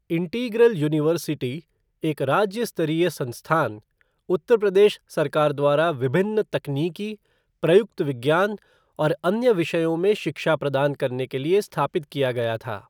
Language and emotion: Hindi, neutral